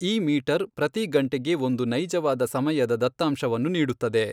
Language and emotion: Kannada, neutral